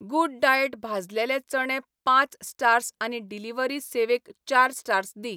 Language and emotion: Goan Konkani, neutral